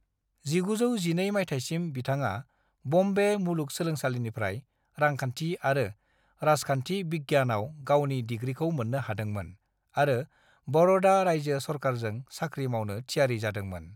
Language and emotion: Bodo, neutral